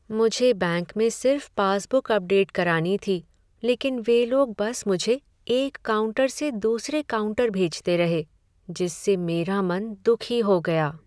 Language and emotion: Hindi, sad